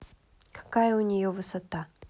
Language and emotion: Russian, neutral